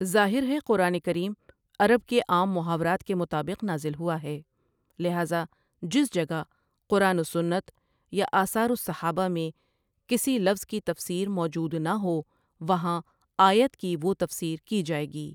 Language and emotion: Urdu, neutral